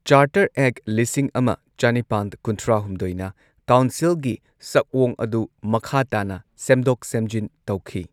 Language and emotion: Manipuri, neutral